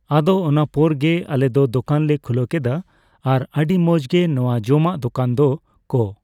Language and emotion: Santali, neutral